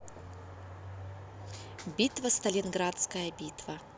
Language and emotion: Russian, neutral